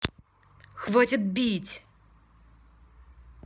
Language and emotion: Russian, angry